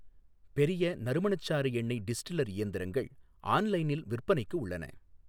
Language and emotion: Tamil, neutral